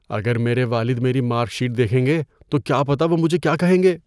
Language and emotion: Urdu, fearful